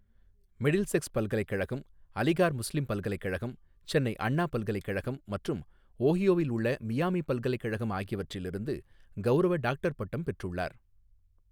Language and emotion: Tamil, neutral